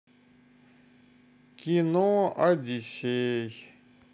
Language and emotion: Russian, sad